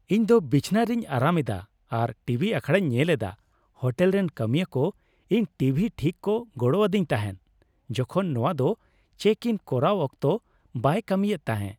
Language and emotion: Santali, happy